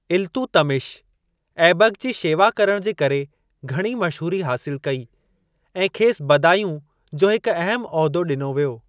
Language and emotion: Sindhi, neutral